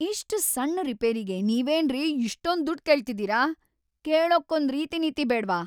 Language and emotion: Kannada, angry